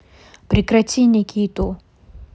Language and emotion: Russian, neutral